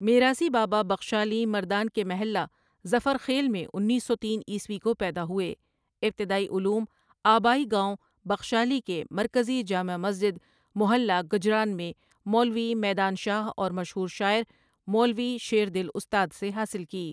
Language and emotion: Urdu, neutral